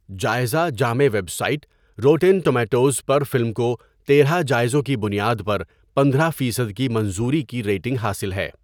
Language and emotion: Urdu, neutral